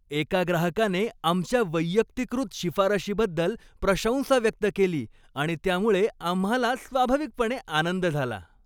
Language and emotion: Marathi, happy